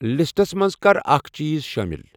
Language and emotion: Kashmiri, neutral